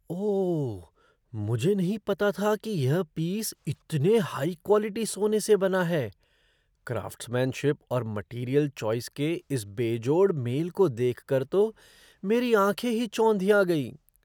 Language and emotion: Hindi, surprised